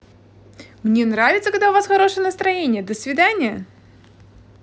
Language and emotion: Russian, positive